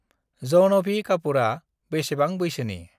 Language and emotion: Bodo, neutral